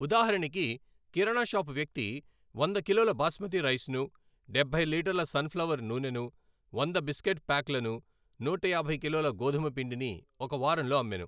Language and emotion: Telugu, neutral